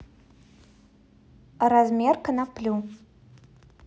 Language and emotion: Russian, neutral